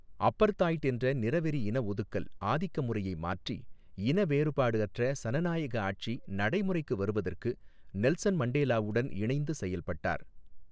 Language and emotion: Tamil, neutral